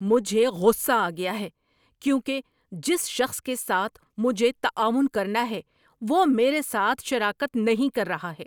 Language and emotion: Urdu, angry